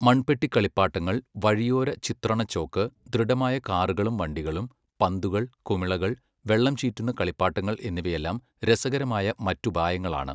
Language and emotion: Malayalam, neutral